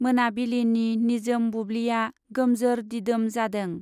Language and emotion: Bodo, neutral